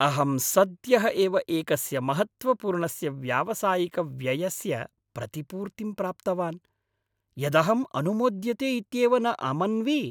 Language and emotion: Sanskrit, happy